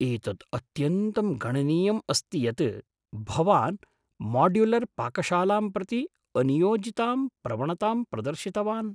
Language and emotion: Sanskrit, surprised